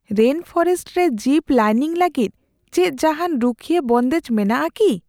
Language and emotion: Santali, fearful